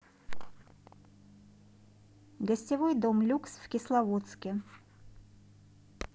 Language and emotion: Russian, neutral